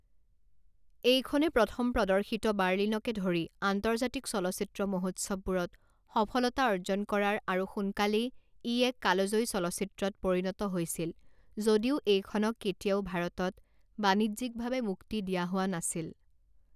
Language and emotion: Assamese, neutral